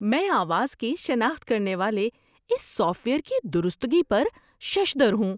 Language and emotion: Urdu, surprised